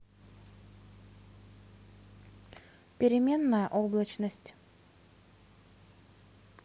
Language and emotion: Russian, neutral